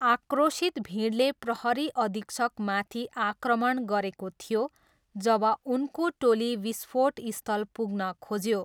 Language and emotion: Nepali, neutral